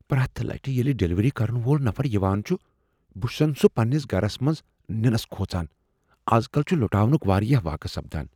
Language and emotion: Kashmiri, fearful